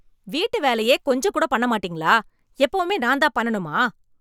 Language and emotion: Tamil, angry